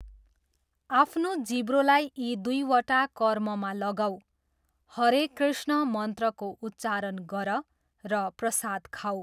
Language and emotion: Nepali, neutral